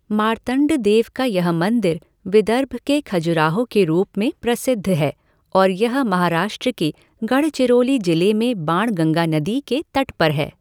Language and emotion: Hindi, neutral